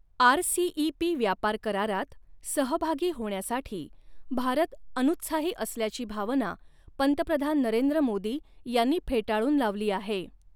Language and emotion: Marathi, neutral